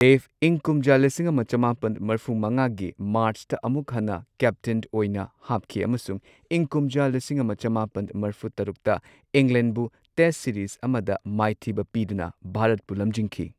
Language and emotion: Manipuri, neutral